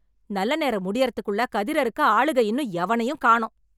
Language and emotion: Tamil, angry